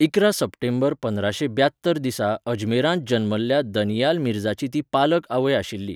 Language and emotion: Goan Konkani, neutral